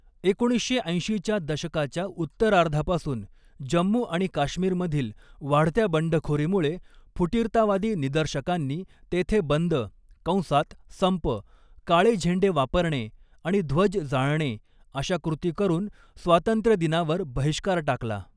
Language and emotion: Marathi, neutral